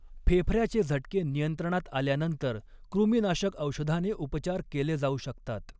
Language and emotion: Marathi, neutral